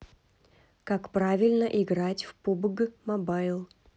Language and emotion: Russian, neutral